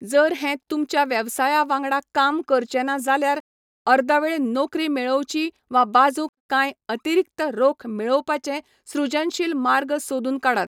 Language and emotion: Goan Konkani, neutral